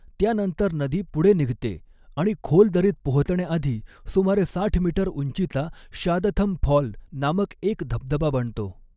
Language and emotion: Marathi, neutral